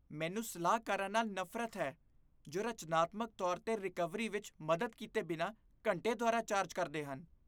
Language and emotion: Punjabi, disgusted